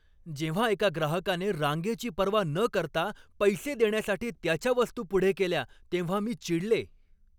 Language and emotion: Marathi, angry